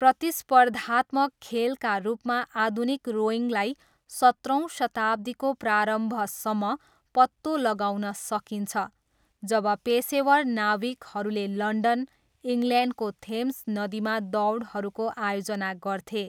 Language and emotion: Nepali, neutral